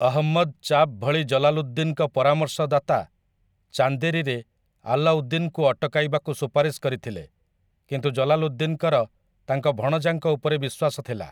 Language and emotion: Odia, neutral